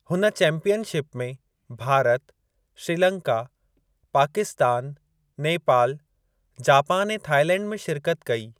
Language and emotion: Sindhi, neutral